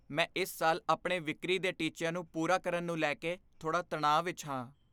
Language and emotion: Punjabi, fearful